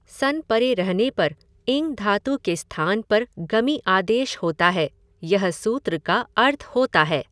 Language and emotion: Hindi, neutral